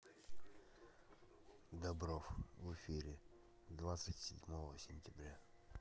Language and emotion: Russian, neutral